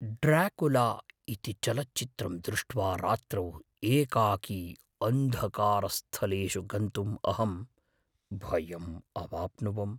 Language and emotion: Sanskrit, fearful